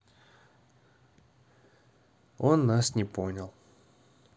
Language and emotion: Russian, neutral